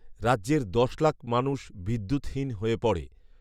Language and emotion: Bengali, neutral